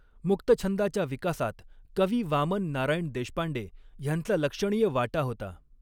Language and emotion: Marathi, neutral